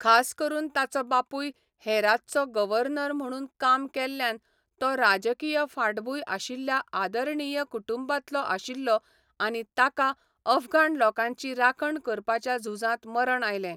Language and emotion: Goan Konkani, neutral